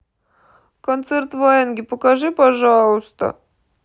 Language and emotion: Russian, sad